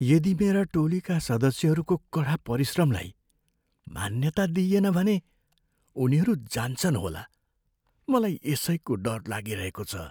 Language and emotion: Nepali, fearful